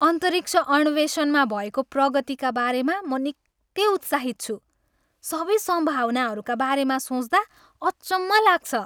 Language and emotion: Nepali, happy